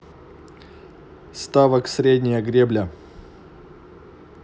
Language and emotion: Russian, neutral